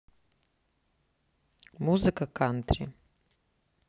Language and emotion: Russian, neutral